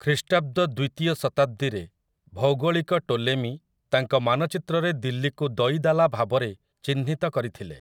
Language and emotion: Odia, neutral